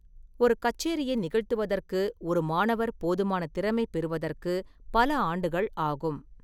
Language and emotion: Tamil, neutral